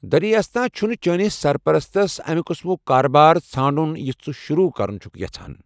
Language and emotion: Kashmiri, neutral